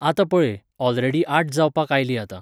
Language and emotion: Goan Konkani, neutral